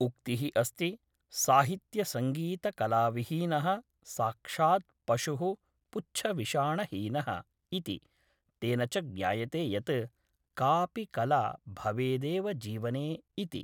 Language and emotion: Sanskrit, neutral